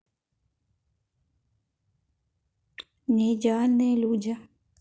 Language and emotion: Russian, neutral